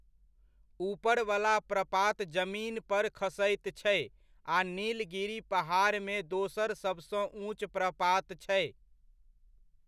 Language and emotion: Maithili, neutral